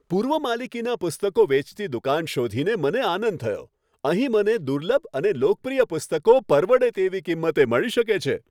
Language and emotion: Gujarati, happy